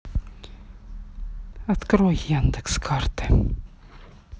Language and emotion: Russian, neutral